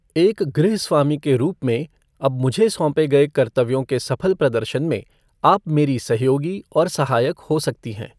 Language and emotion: Hindi, neutral